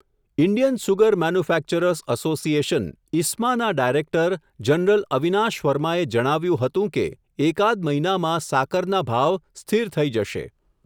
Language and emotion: Gujarati, neutral